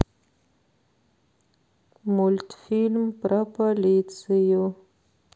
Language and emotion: Russian, sad